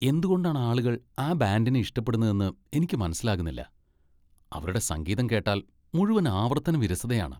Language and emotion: Malayalam, disgusted